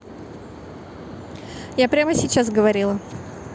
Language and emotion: Russian, neutral